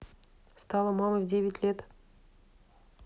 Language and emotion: Russian, neutral